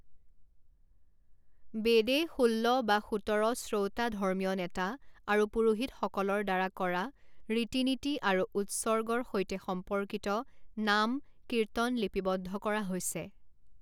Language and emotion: Assamese, neutral